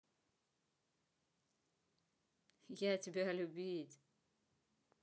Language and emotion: Russian, positive